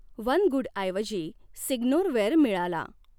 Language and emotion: Marathi, neutral